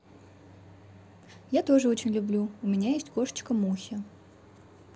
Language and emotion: Russian, positive